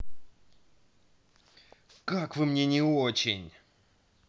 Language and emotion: Russian, angry